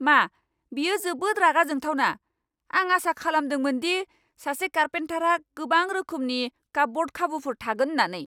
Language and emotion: Bodo, angry